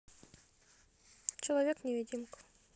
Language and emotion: Russian, neutral